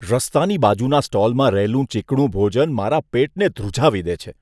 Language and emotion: Gujarati, disgusted